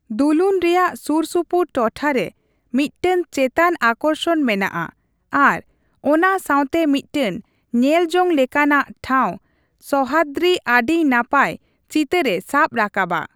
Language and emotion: Santali, neutral